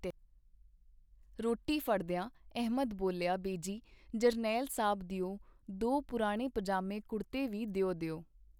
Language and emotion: Punjabi, neutral